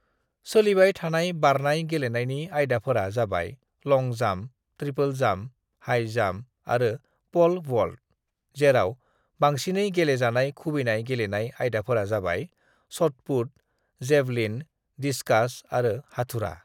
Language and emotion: Bodo, neutral